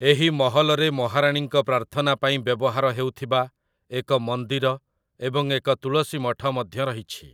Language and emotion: Odia, neutral